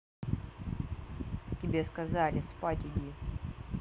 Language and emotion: Russian, angry